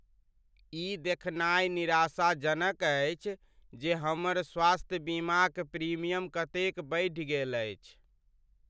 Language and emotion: Maithili, sad